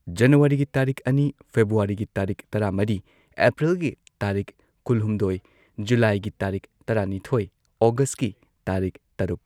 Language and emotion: Manipuri, neutral